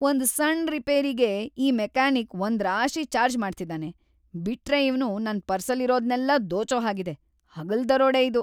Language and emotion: Kannada, angry